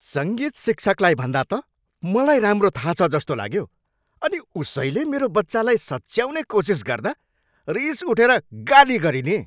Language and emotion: Nepali, angry